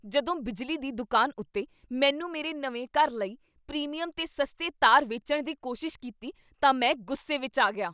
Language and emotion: Punjabi, angry